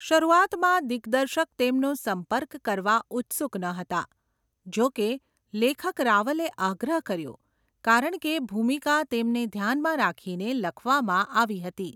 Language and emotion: Gujarati, neutral